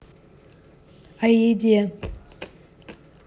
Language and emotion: Russian, neutral